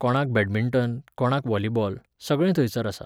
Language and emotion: Goan Konkani, neutral